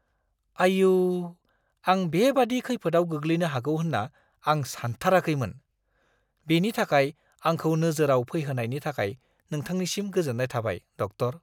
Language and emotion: Bodo, surprised